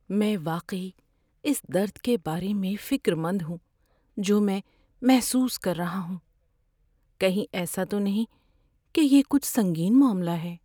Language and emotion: Urdu, fearful